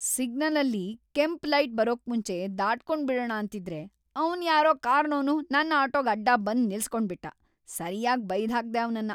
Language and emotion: Kannada, angry